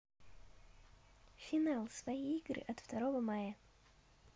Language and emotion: Russian, neutral